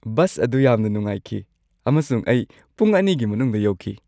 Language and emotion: Manipuri, happy